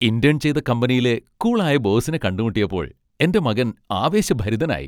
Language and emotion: Malayalam, happy